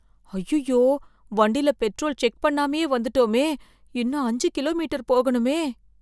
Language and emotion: Tamil, fearful